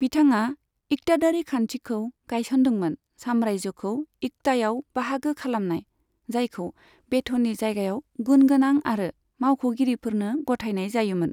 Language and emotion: Bodo, neutral